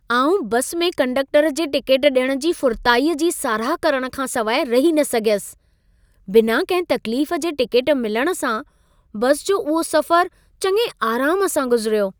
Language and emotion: Sindhi, happy